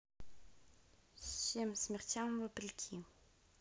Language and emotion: Russian, neutral